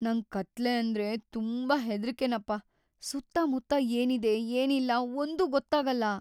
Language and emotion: Kannada, fearful